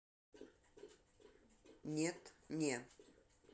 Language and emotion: Russian, neutral